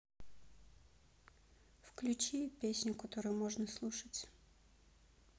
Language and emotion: Russian, neutral